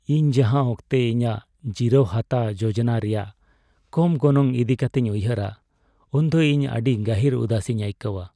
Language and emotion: Santali, sad